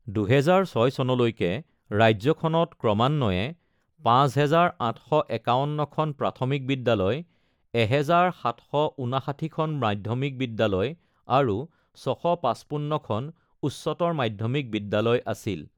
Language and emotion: Assamese, neutral